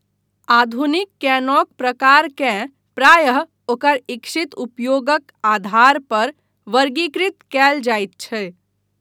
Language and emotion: Maithili, neutral